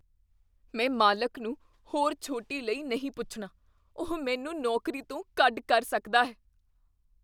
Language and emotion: Punjabi, fearful